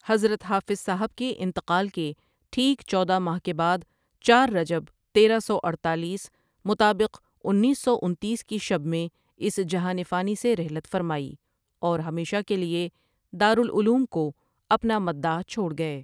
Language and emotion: Urdu, neutral